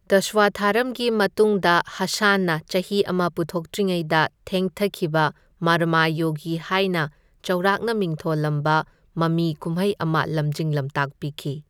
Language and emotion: Manipuri, neutral